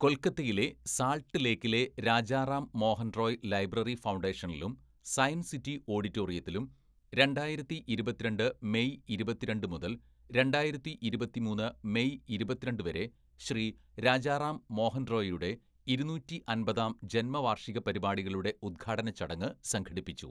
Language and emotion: Malayalam, neutral